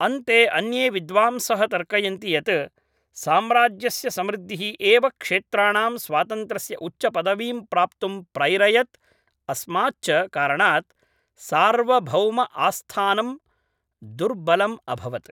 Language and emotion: Sanskrit, neutral